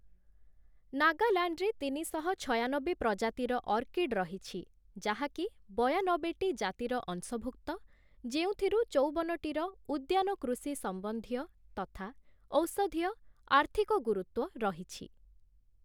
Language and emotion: Odia, neutral